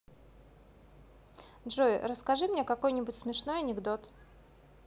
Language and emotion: Russian, neutral